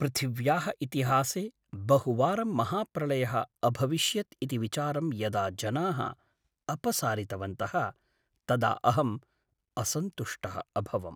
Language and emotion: Sanskrit, sad